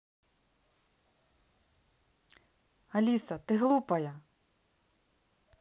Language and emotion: Russian, neutral